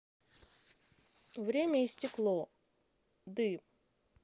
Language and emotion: Russian, neutral